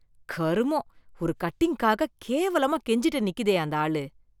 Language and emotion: Tamil, disgusted